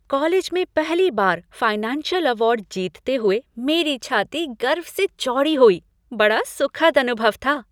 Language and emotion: Hindi, happy